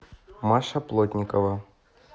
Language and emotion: Russian, neutral